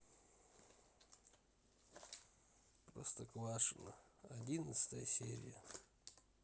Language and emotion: Russian, sad